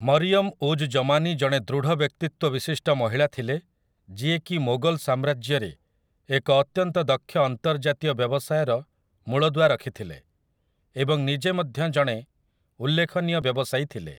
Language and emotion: Odia, neutral